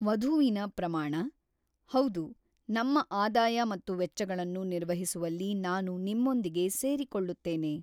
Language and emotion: Kannada, neutral